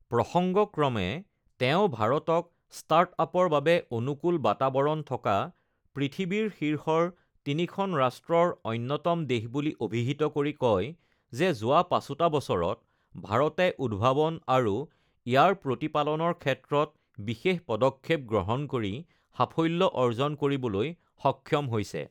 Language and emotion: Assamese, neutral